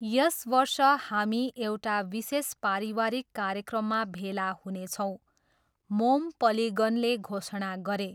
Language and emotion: Nepali, neutral